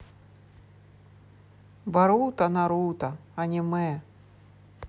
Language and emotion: Russian, neutral